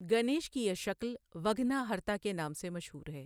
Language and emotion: Urdu, neutral